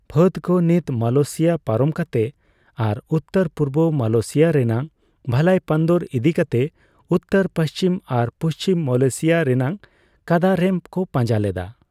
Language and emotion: Santali, neutral